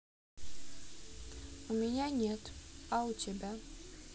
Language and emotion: Russian, neutral